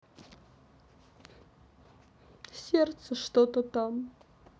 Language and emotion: Russian, sad